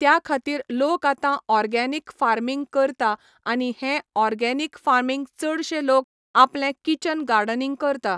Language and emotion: Goan Konkani, neutral